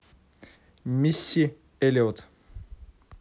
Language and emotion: Russian, neutral